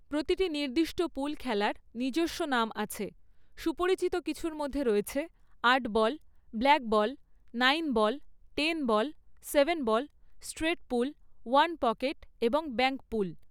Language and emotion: Bengali, neutral